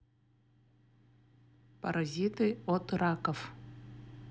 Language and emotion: Russian, neutral